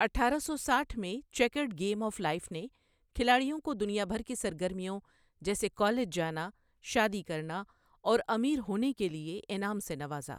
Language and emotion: Urdu, neutral